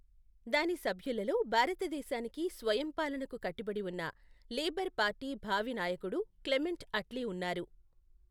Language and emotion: Telugu, neutral